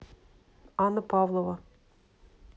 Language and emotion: Russian, neutral